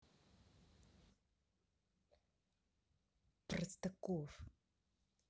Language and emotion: Russian, angry